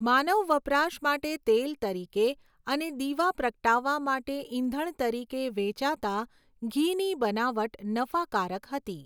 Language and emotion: Gujarati, neutral